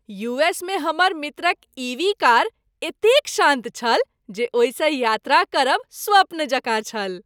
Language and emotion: Maithili, happy